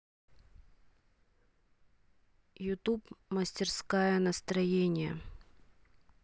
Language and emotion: Russian, neutral